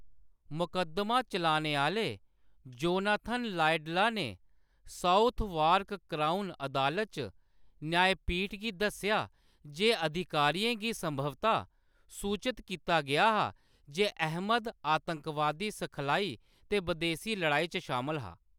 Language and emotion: Dogri, neutral